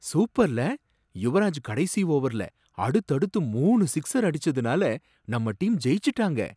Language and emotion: Tamil, surprised